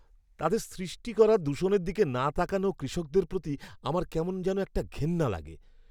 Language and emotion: Bengali, disgusted